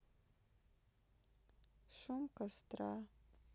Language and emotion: Russian, sad